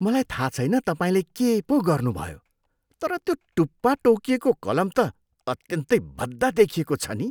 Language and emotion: Nepali, disgusted